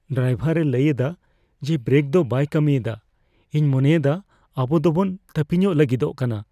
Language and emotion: Santali, fearful